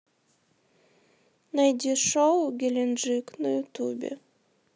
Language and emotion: Russian, sad